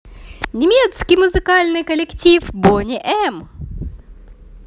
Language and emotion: Russian, positive